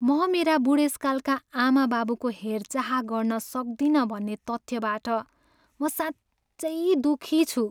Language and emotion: Nepali, sad